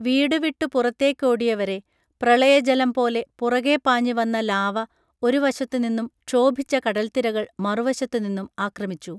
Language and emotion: Malayalam, neutral